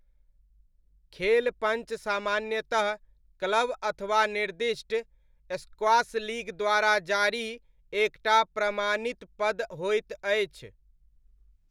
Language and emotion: Maithili, neutral